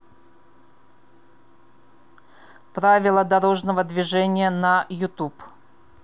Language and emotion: Russian, neutral